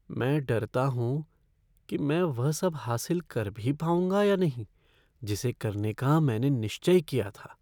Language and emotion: Hindi, fearful